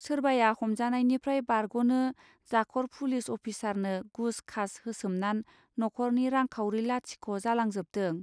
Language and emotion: Bodo, neutral